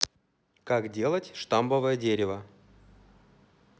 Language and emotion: Russian, neutral